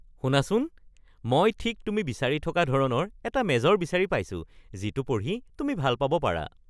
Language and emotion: Assamese, happy